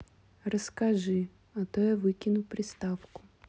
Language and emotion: Russian, neutral